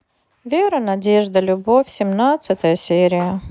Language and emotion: Russian, sad